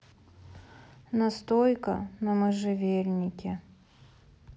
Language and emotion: Russian, sad